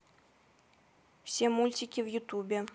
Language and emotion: Russian, neutral